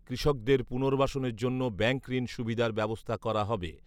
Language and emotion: Bengali, neutral